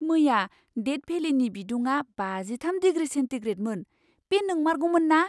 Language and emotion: Bodo, surprised